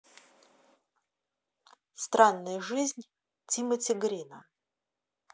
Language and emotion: Russian, neutral